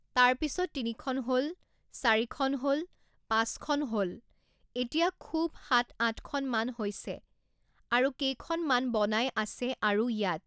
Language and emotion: Assamese, neutral